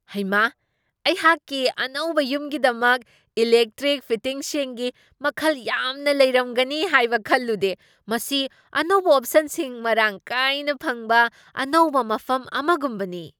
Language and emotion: Manipuri, surprised